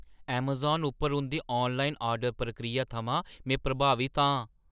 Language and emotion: Dogri, surprised